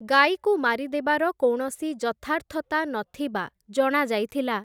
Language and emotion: Odia, neutral